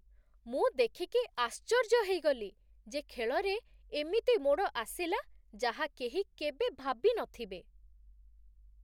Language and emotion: Odia, surprised